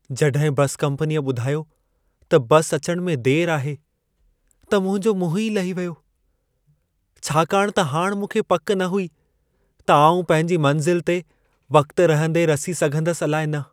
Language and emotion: Sindhi, sad